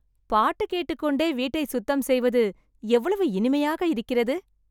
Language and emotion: Tamil, happy